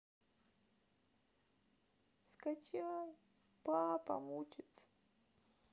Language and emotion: Russian, sad